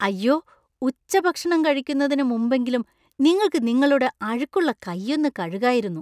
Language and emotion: Malayalam, disgusted